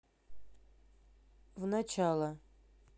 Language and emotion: Russian, neutral